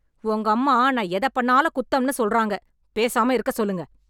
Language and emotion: Tamil, angry